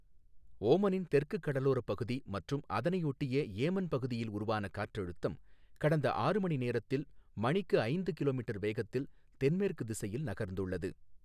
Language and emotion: Tamil, neutral